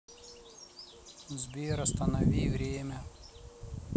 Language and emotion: Russian, neutral